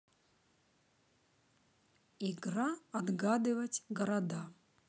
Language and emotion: Russian, neutral